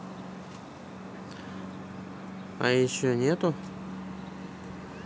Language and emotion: Russian, neutral